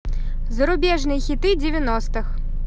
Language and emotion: Russian, positive